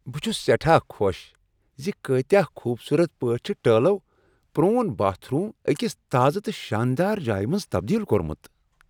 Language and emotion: Kashmiri, happy